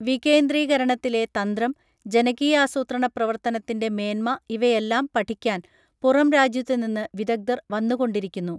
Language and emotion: Malayalam, neutral